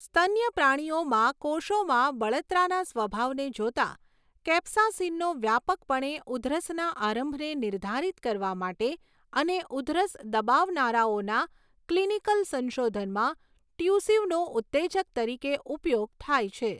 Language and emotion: Gujarati, neutral